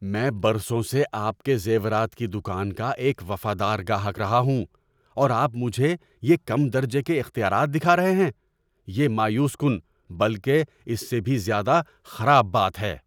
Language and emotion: Urdu, angry